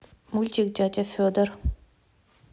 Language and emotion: Russian, neutral